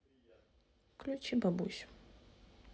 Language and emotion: Russian, sad